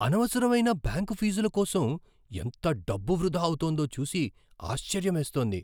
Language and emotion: Telugu, surprised